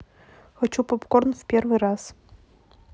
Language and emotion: Russian, neutral